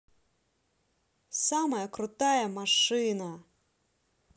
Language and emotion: Russian, positive